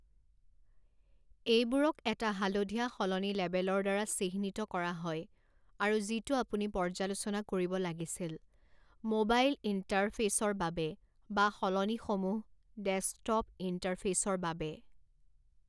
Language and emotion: Assamese, neutral